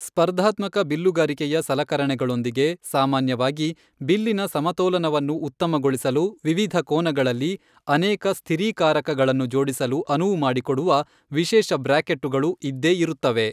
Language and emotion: Kannada, neutral